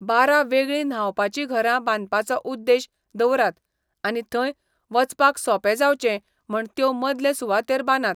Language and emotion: Goan Konkani, neutral